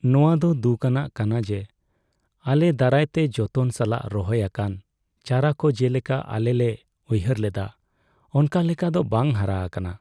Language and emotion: Santali, sad